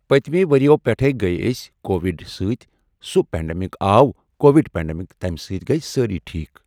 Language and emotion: Kashmiri, neutral